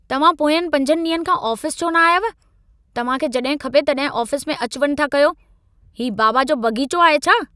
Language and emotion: Sindhi, angry